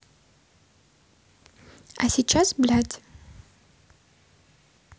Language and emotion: Russian, neutral